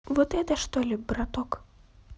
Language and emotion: Russian, neutral